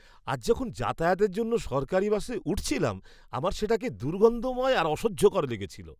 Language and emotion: Bengali, disgusted